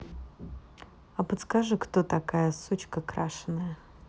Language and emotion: Russian, neutral